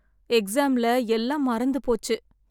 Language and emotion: Tamil, sad